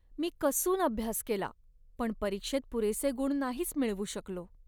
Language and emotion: Marathi, sad